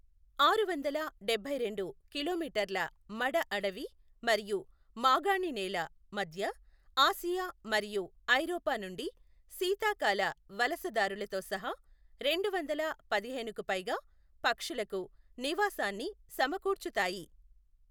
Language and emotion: Telugu, neutral